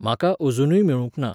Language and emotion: Goan Konkani, neutral